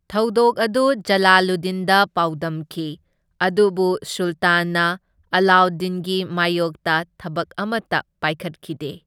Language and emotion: Manipuri, neutral